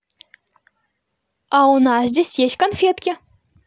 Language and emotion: Russian, positive